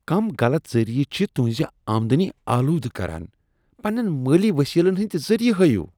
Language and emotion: Kashmiri, disgusted